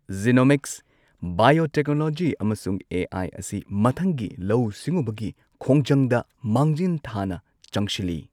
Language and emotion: Manipuri, neutral